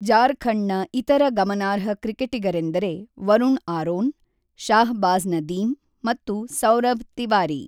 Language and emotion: Kannada, neutral